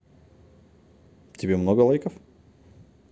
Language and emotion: Russian, positive